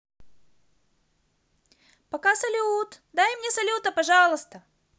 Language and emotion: Russian, positive